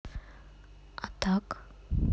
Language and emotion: Russian, neutral